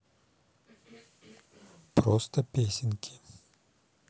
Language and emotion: Russian, neutral